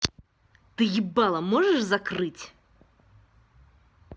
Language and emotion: Russian, angry